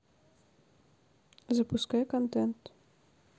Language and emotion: Russian, neutral